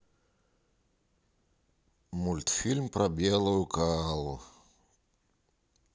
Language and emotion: Russian, sad